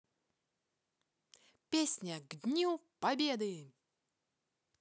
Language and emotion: Russian, positive